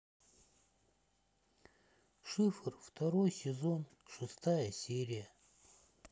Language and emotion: Russian, sad